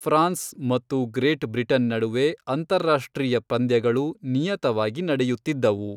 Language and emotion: Kannada, neutral